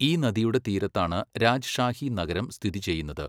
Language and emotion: Malayalam, neutral